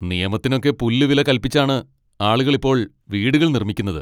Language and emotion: Malayalam, angry